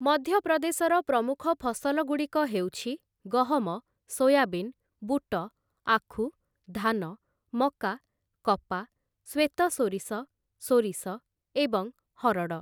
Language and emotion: Odia, neutral